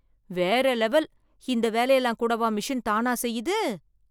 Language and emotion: Tamil, surprised